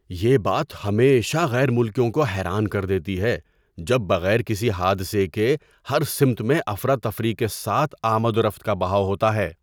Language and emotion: Urdu, surprised